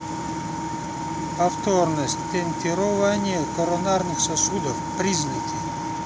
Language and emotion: Russian, neutral